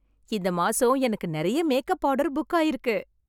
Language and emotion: Tamil, happy